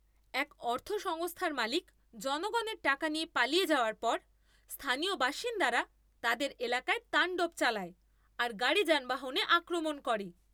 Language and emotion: Bengali, angry